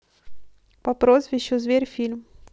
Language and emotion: Russian, neutral